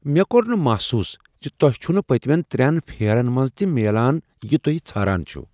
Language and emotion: Kashmiri, surprised